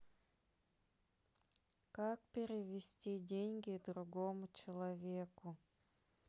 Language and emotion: Russian, sad